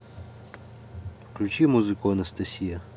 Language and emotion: Russian, neutral